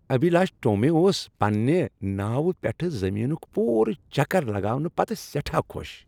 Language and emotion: Kashmiri, happy